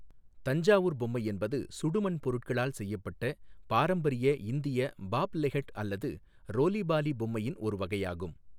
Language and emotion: Tamil, neutral